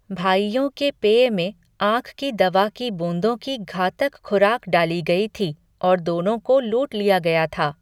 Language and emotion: Hindi, neutral